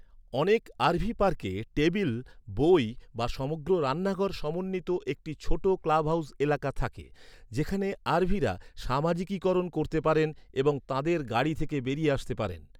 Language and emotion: Bengali, neutral